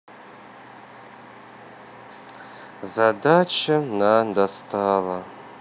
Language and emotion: Russian, sad